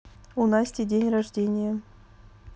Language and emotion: Russian, neutral